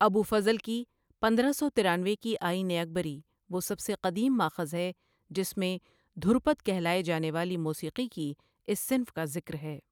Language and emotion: Urdu, neutral